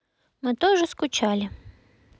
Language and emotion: Russian, neutral